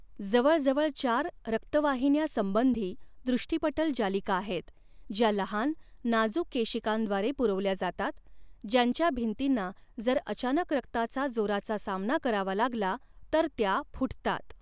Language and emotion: Marathi, neutral